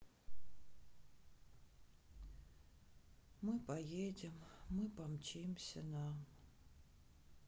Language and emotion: Russian, sad